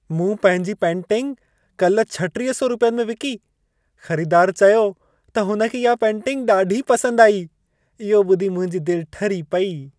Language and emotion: Sindhi, happy